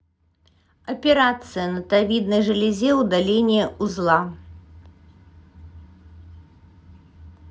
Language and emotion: Russian, neutral